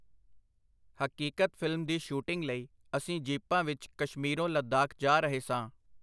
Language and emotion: Punjabi, neutral